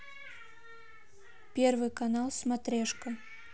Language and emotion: Russian, neutral